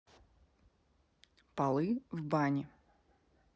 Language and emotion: Russian, neutral